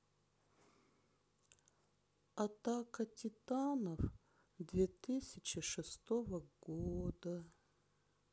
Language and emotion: Russian, sad